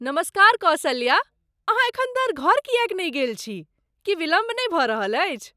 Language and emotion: Maithili, surprised